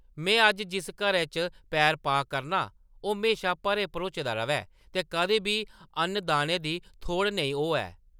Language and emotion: Dogri, neutral